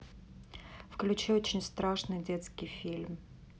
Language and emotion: Russian, neutral